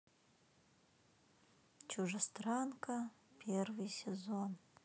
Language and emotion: Russian, sad